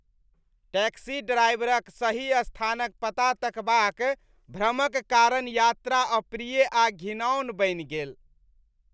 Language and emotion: Maithili, disgusted